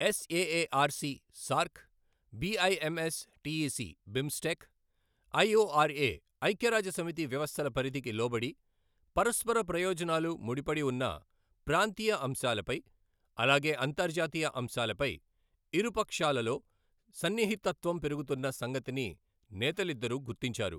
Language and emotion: Telugu, neutral